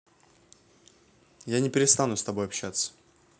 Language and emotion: Russian, neutral